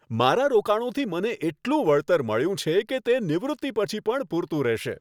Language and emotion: Gujarati, happy